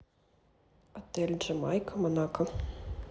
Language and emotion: Russian, neutral